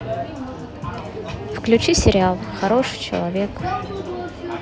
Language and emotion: Russian, neutral